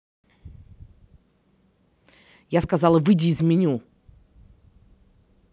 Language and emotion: Russian, angry